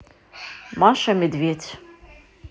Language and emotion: Russian, neutral